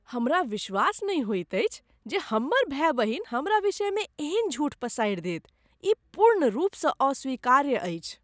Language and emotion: Maithili, disgusted